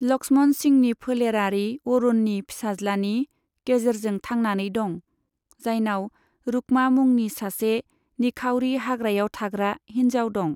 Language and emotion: Bodo, neutral